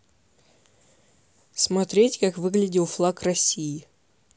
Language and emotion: Russian, neutral